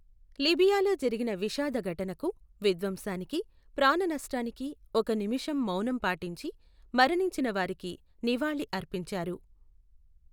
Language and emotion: Telugu, neutral